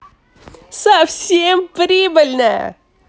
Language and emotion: Russian, positive